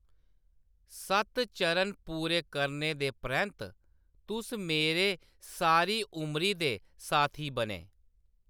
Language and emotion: Dogri, neutral